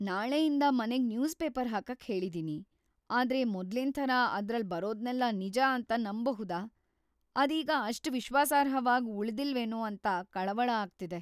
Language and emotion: Kannada, fearful